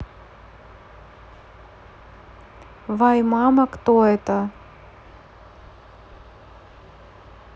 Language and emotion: Russian, neutral